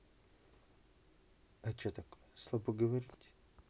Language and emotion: Russian, neutral